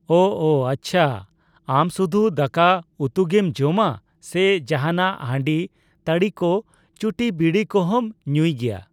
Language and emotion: Santali, neutral